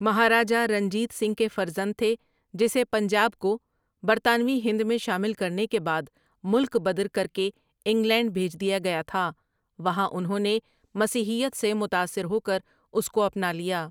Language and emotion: Urdu, neutral